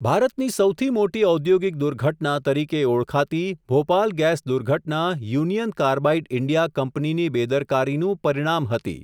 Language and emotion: Gujarati, neutral